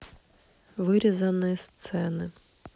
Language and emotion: Russian, neutral